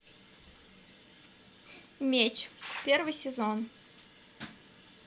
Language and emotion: Russian, neutral